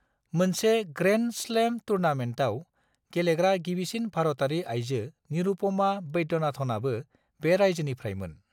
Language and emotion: Bodo, neutral